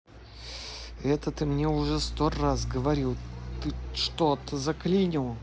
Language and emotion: Russian, angry